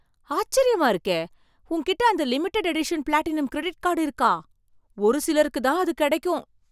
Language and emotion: Tamil, surprised